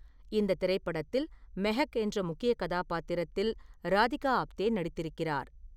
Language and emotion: Tamil, neutral